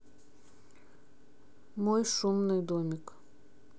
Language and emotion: Russian, neutral